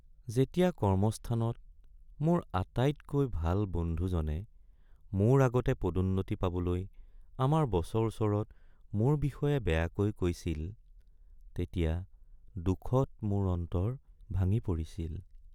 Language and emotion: Assamese, sad